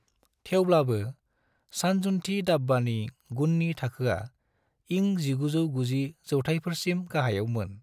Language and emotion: Bodo, neutral